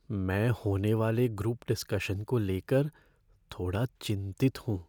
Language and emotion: Hindi, fearful